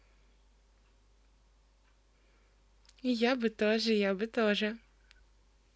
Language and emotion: Russian, positive